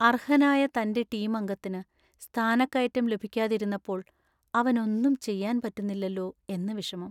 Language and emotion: Malayalam, sad